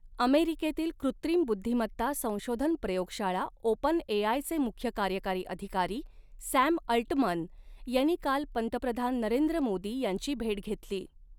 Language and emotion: Marathi, neutral